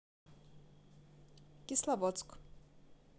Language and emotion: Russian, neutral